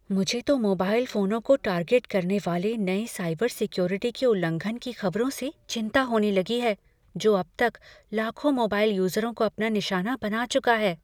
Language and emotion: Hindi, fearful